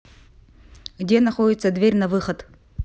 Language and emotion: Russian, neutral